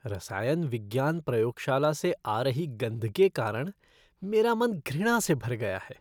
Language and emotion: Hindi, disgusted